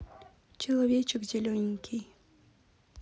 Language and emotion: Russian, neutral